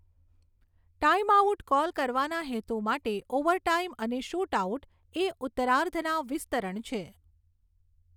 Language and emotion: Gujarati, neutral